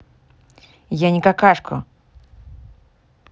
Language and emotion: Russian, angry